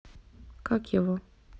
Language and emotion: Russian, neutral